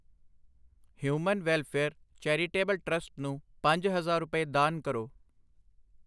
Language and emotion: Punjabi, neutral